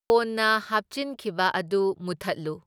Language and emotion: Manipuri, neutral